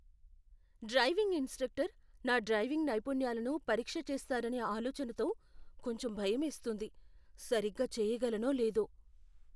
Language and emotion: Telugu, fearful